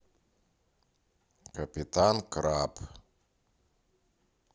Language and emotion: Russian, neutral